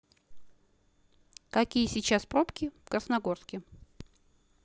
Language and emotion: Russian, neutral